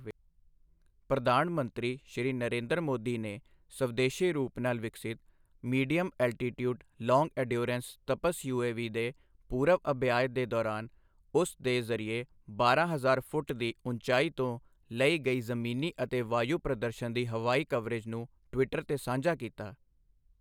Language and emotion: Punjabi, neutral